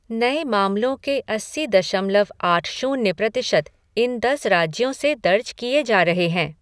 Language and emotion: Hindi, neutral